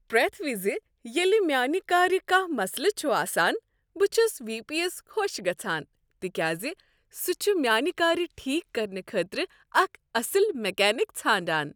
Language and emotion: Kashmiri, happy